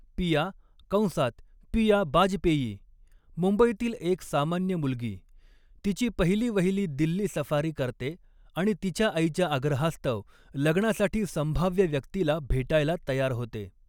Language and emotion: Marathi, neutral